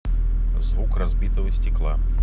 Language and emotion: Russian, neutral